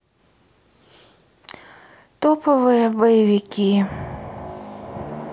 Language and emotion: Russian, sad